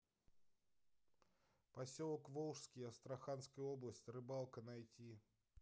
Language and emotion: Russian, neutral